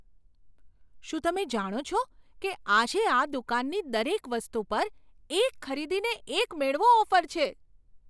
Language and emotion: Gujarati, surprised